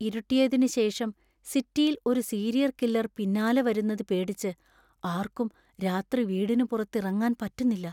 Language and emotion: Malayalam, fearful